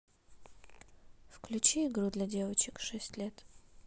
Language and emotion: Russian, sad